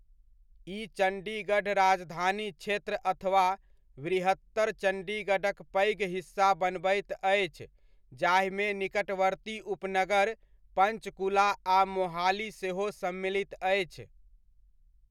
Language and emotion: Maithili, neutral